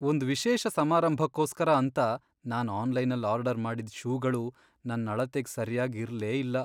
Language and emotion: Kannada, sad